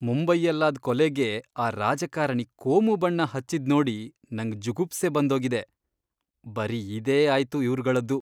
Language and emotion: Kannada, disgusted